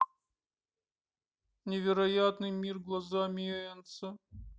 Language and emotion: Russian, sad